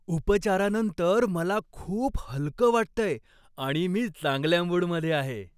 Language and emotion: Marathi, happy